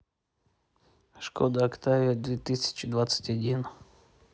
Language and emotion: Russian, neutral